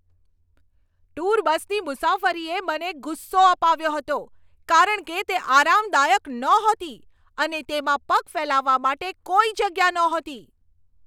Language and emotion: Gujarati, angry